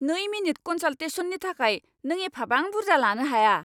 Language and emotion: Bodo, angry